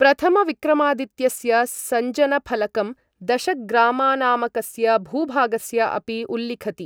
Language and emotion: Sanskrit, neutral